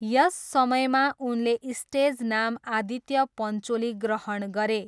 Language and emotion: Nepali, neutral